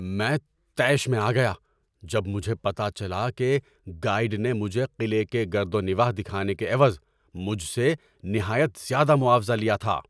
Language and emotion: Urdu, angry